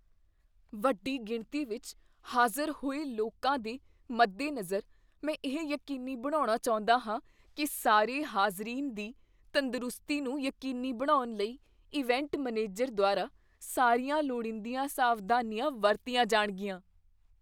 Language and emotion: Punjabi, fearful